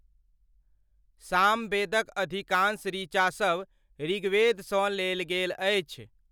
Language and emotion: Maithili, neutral